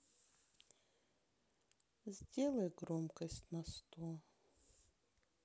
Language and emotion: Russian, sad